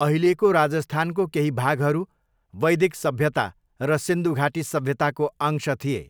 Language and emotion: Nepali, neutral